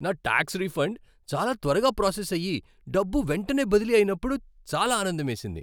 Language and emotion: Telugu, happy